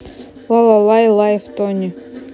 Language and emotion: Russian, neutral